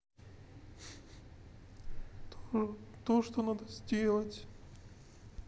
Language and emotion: Russian, sad